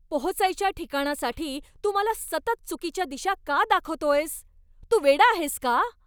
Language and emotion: Marathi, angry